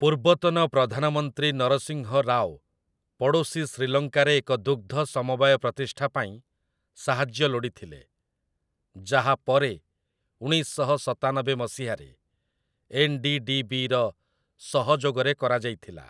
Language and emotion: Odia, neutral